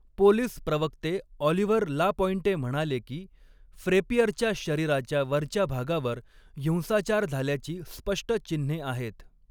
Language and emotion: Marathi, neutral